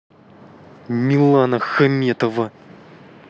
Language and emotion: Russian, angry